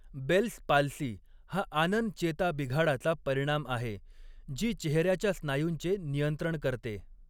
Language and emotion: Marathi, neutral